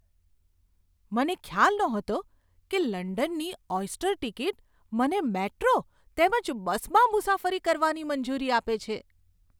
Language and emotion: Gujarati, surprised